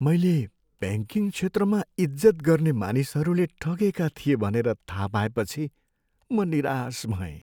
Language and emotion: Nepali, sad